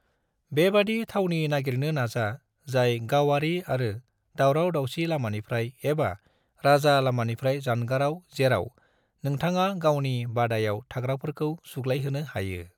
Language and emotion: Bodo, neutral